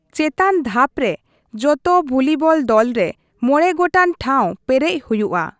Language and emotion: Santali, neutral